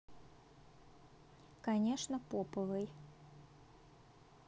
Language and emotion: Russian, neutral